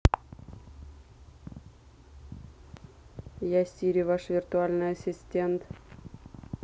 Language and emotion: Russian, neutral